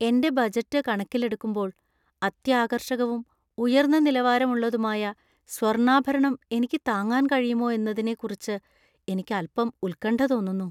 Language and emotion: Malayalam, fearful